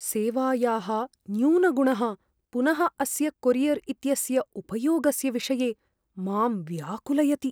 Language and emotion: Sanskrit, fearful